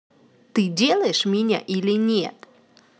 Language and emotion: Russian, angry